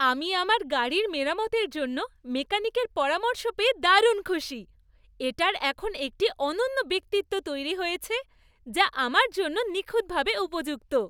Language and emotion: Bengali, happy